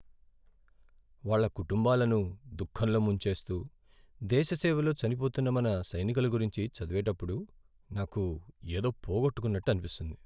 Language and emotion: Telugu, sad